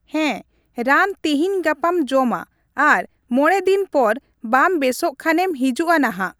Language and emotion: Santali, neutral